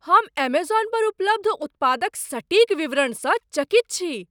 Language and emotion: Maithili, surprised